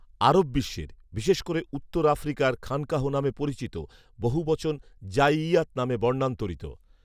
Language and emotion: Bengali, neutral